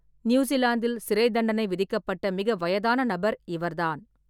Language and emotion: Tamil, neutral